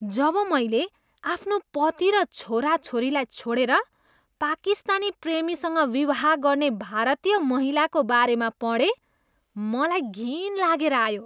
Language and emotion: Nepali, disgusted